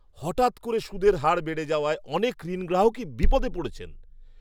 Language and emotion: Bengali, surprised